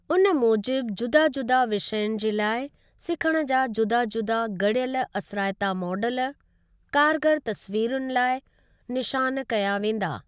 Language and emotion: Sindhi, neutral